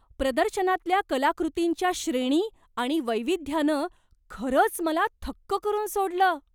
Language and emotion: Marathi, surprised